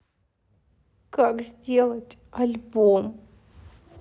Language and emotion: Russian, sad